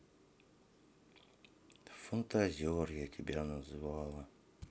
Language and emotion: Russian, sad